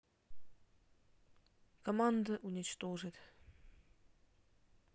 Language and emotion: Russian, neutral